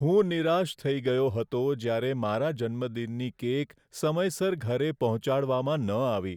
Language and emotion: Gujarati, sad